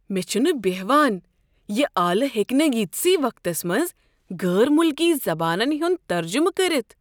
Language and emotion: Kashmiri, surprised